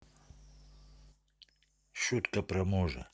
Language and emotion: Russian, neutral